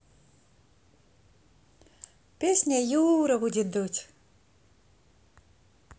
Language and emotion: Russian, positive